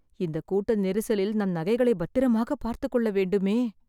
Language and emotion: Tamil, fearful